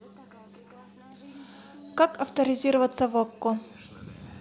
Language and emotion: Russian, neutral